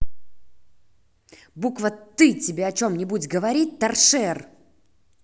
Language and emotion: Russian, angry